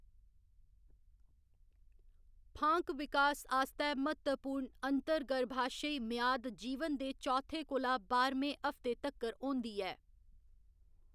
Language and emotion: Dogri, neutral